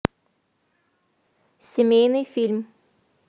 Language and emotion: Russian, neutral